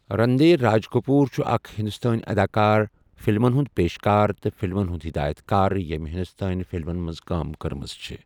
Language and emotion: Kashmiri, neutral